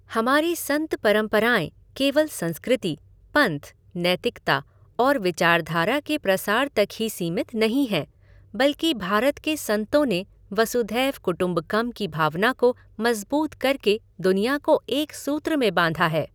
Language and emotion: Hindi, neutral